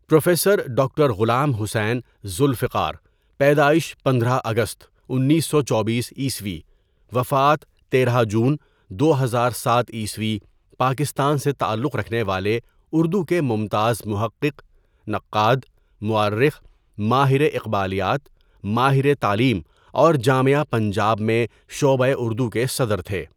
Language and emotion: Urdu, neutral